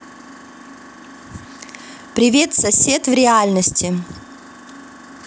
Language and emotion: Russian, positive